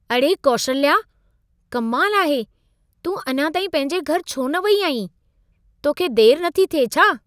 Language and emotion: Sindhi, surprised